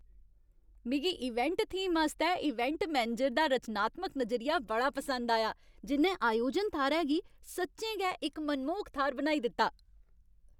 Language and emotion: Dogri, happy